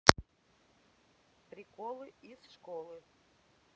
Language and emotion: Russian, neutral